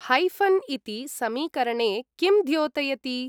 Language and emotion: Sanskrit, neutral